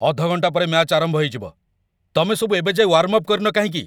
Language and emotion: Odia, angry